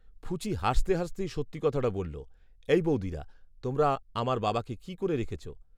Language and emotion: Bengali, neutral